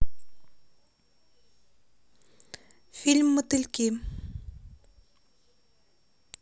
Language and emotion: Russian, neutral